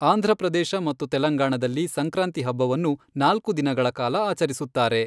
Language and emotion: Kannada, neutral